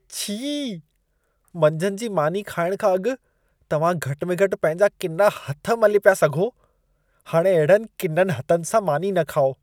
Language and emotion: Sindhi, disgusted